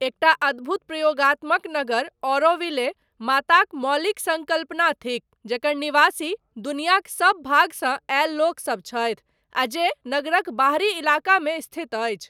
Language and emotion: Maithili, neutral